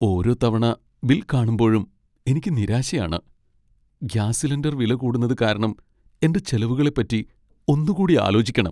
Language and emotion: Malayalam, sad